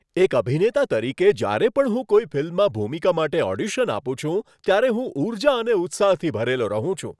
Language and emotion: Gujarati, happy